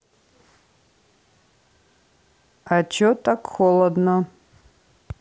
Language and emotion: Russian, neutral